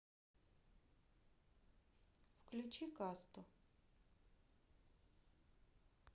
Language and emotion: Russian, neutral